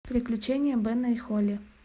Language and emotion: Russian, neutral